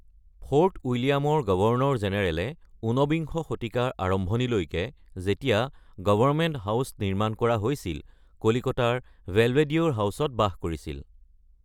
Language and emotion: Assamese, neutral